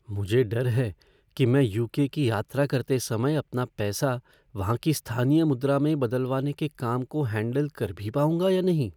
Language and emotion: Hindi, fearful